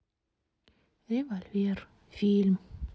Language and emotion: Russian, sad